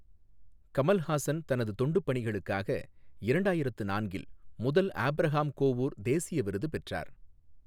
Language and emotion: Tamil, neutral